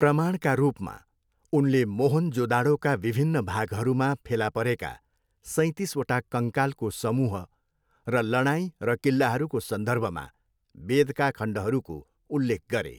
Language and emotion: Nepali, neutral